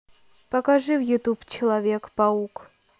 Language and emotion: Russian, neutral